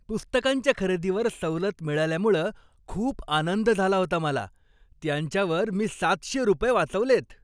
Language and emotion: Marathi, happy